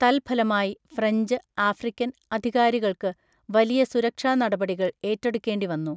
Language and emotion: Malayalam, neutral